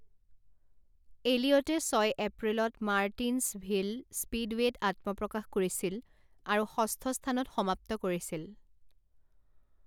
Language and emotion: Assamese, neutral